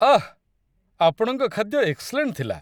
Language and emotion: Odia, happy